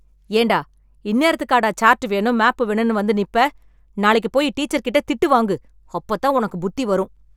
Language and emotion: Tamil, angry